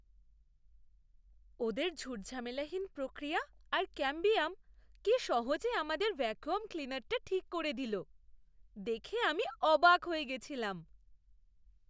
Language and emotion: Bengali, surprised